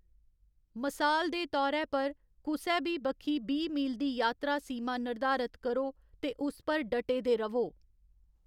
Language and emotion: Dogri, neutral